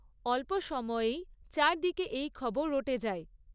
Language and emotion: Bengali, neutral